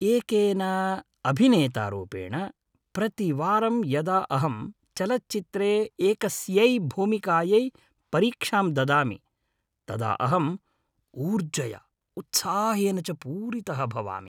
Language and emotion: Sanskrit, happy